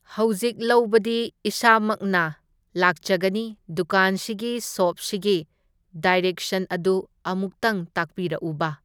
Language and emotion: Manipuri, neutral